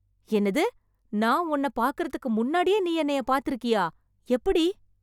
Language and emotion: Tamil, surprised